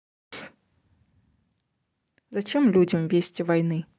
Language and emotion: Russian, neutral